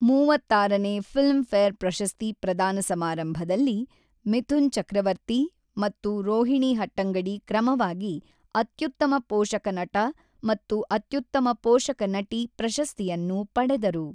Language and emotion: Kannada, neutral